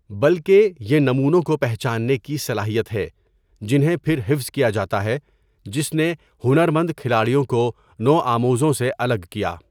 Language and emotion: Urdu, neutral